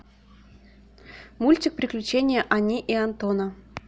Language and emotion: Russian, neutral